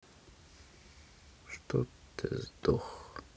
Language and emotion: Russian, sad